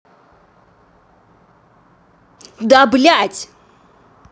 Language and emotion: Russian, angry